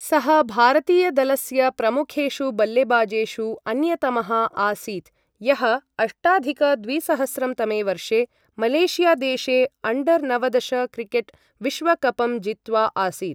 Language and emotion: Sanskrit, neutral